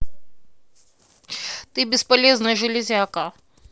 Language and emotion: Russian, angry